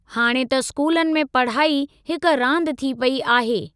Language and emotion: Sindhi, neutral